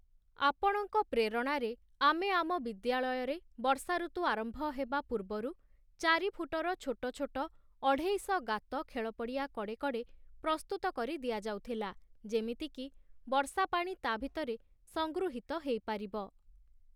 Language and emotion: Odia, neutral